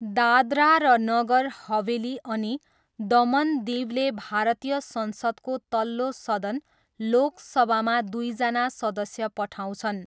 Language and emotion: Nepali, neutral